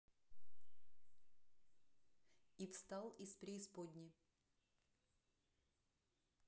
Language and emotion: Russian, neutral